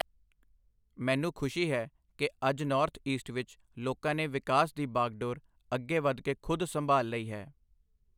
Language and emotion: Punjabi, neutral